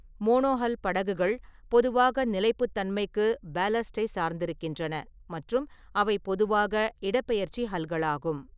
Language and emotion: Tamil, neutral